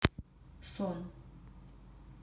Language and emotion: Russian, neutral